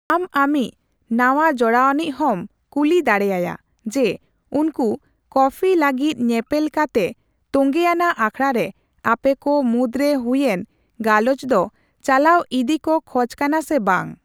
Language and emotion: Santali, neutral